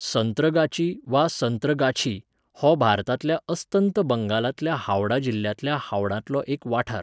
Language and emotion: Goan Konkani, neutral